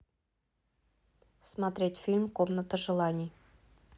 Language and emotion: Russian, neutral